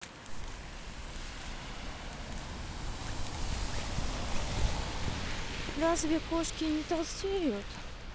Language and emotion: Russian, neutral